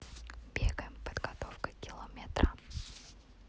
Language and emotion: Russian, neutral